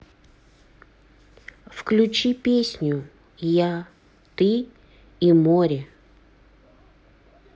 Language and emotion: Russian, neutral